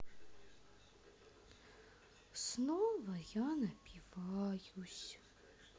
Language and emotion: Russian, sad